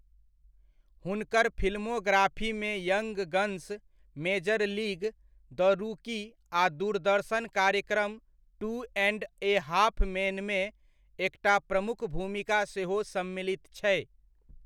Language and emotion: Maithili, neutral